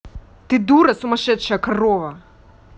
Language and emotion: Russian, angry